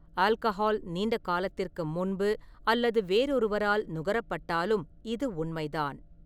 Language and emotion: Tamil, neutral